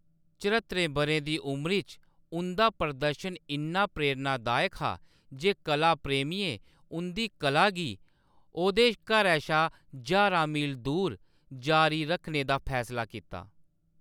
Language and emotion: Dogri, neutral